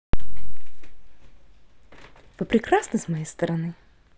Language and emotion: Russian, positive